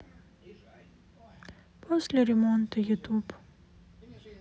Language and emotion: Russian, sad